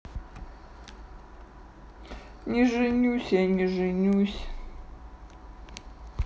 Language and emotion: Russian, sad